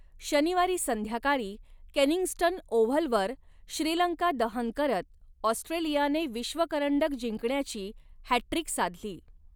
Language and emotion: Marathi, neutral